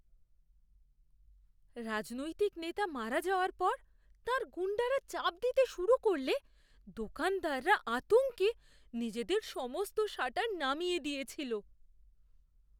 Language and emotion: Bengali, fearful